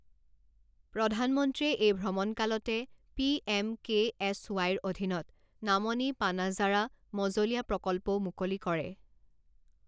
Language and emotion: Assamese, neutral